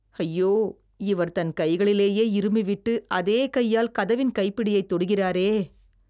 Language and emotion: Tamil, disgusted